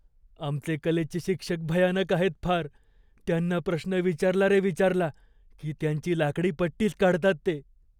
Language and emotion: Marathi, fearful